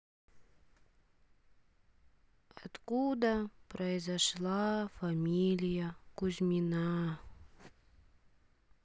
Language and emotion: Russian, sad